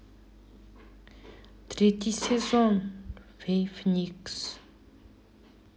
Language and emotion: Russian, sad